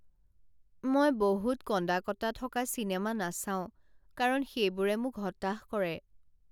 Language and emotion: Assamese, sad